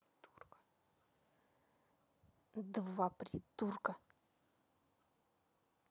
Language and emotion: Russian, angry